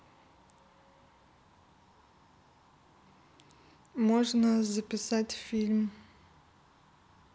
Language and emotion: Russian, neutral